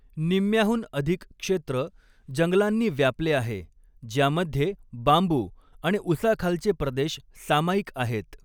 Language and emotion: Marathi, neutral